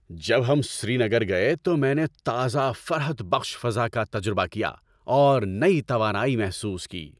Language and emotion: Urdu, happy